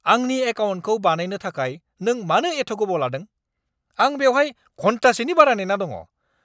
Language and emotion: Bodo, angry